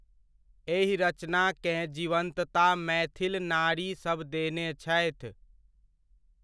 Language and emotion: Maithili, neutral